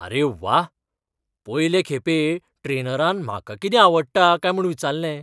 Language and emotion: Goan Konkani, surprised